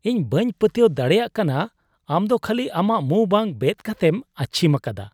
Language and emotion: Santali, disgusted